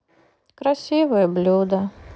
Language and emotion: Russian, sad